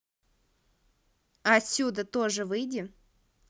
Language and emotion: Russian, neutral